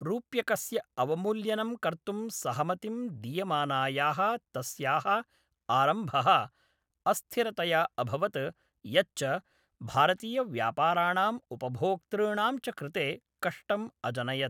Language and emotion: Sanskrit, neutral